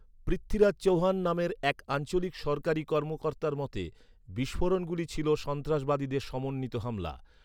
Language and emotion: Bengali, neutral